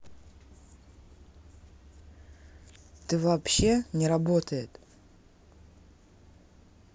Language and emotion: Russian, neutral